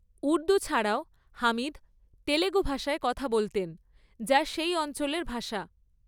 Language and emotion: Bengali, neutral